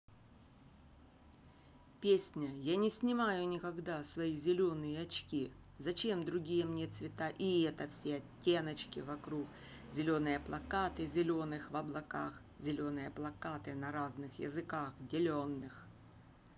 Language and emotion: Russian, neutral